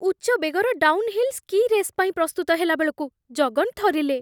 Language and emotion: Odia, fearful